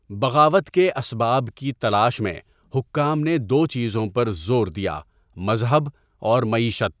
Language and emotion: Urdu, neutral